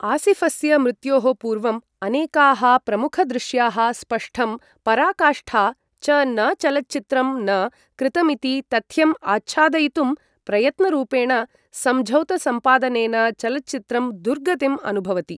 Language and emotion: Sanskrit, neutral